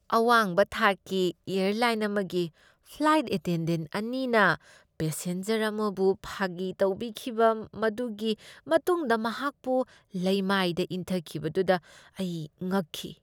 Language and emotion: Manipuri, disgusted